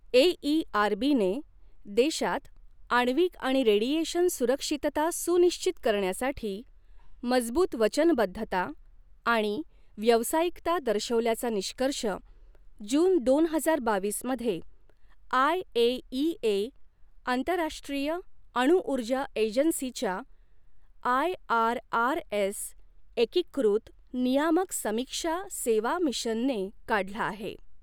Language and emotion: Marathi, neutral